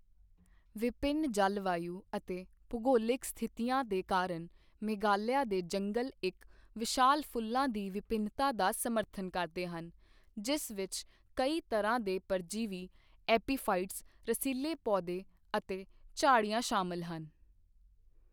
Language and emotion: Punjabi, neutral